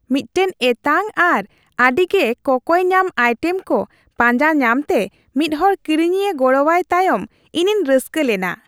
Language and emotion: Santali, happy